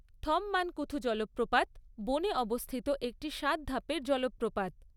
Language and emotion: Bengali, neutral